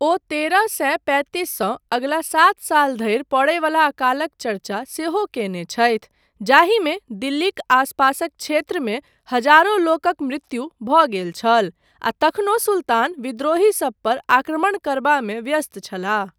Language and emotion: Maithili, neutral